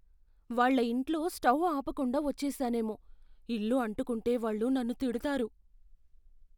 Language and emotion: Telugu, fearful